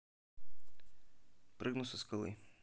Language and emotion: Russian, neutral